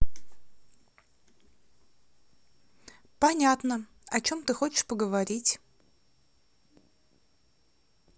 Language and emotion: Russian, neutral